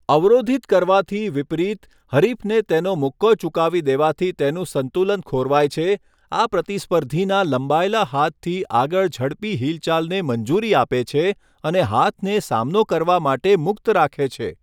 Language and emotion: Gujarati, neutral